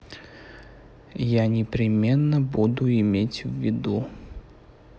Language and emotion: Russian, neutral